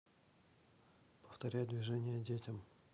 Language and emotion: Russian, neutral